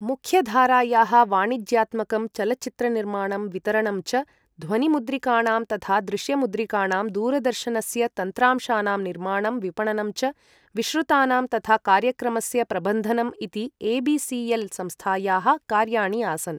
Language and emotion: Sanskrit, neutral